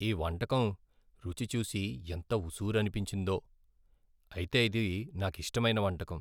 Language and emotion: Telugu, sad